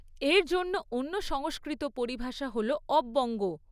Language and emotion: Bengali, neutral